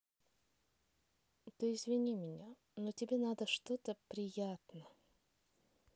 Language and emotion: Russian, sad